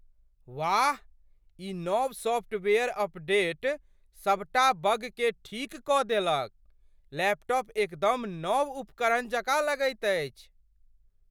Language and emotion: Maithili, surprised